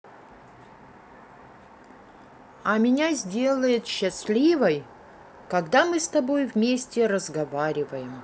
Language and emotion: Russian, neutral